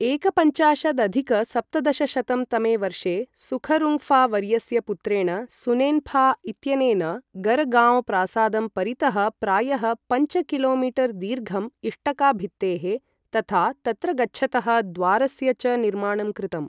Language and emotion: Sanskrit, neutral